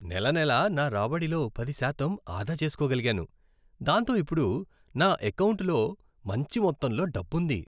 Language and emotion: Telugu, happy